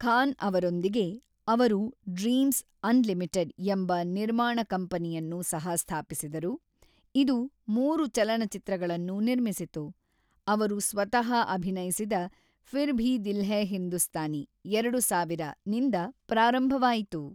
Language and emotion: Kannada, neutral